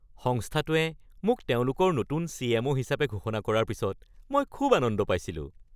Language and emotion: Assamese, happy